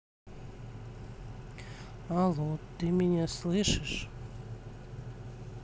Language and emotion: Russian, sad